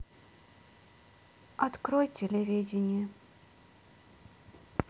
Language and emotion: Russian, sad